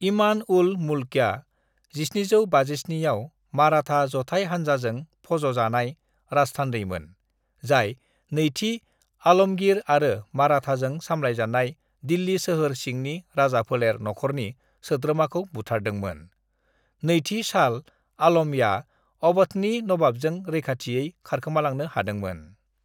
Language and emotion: Bodo, neutral